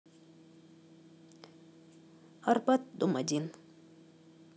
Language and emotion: Russian, neutral